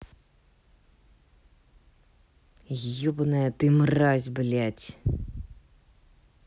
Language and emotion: Russian, angry